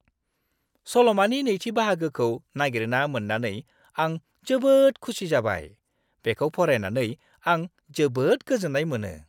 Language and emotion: Bodo, happy